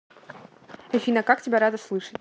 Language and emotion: Russian, neutral